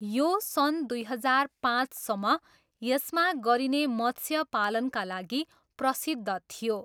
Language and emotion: Nepali, neutral